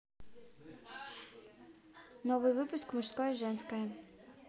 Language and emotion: Russian, neutral